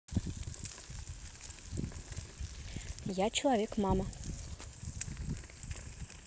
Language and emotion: Russian, neutral